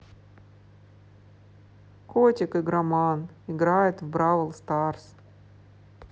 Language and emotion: Russian, sad